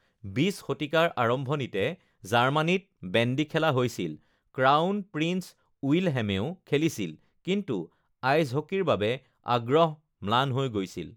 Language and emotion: Assamese, neutral